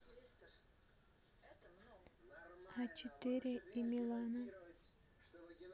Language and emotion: Russian, neutral